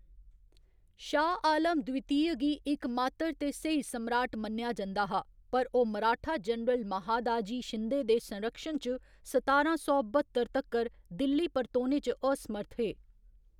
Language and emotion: Dogri, neutral